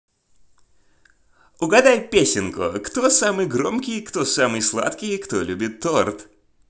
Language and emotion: Russian, positive